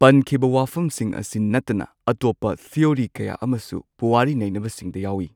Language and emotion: Manipuri, neutral